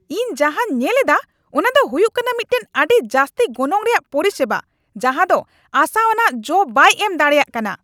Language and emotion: Santali, angry